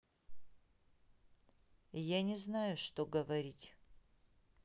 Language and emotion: Russian, neutral